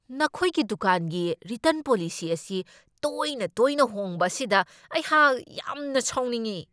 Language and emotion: Manipuri, angry